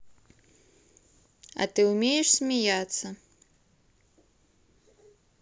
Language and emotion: Russian, neutral